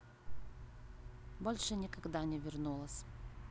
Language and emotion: Russian, neutral